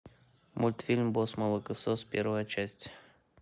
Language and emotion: Russian, neutral